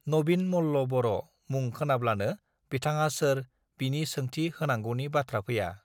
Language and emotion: Bodo, neutral